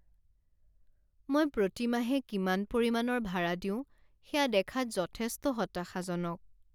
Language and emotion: Assamese, sad